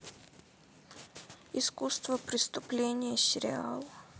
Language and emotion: Russian, sad